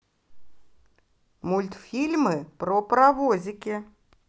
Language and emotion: Russian, positive